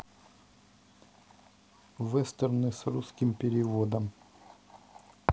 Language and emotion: Russian, neutral